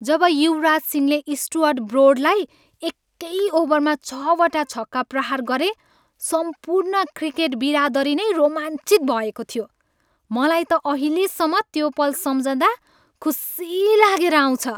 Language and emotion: Nepali, happy